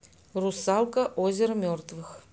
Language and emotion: Russian, neutral